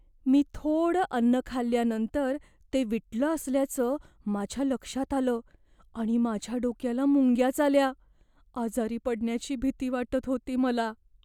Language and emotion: Marathi, fearful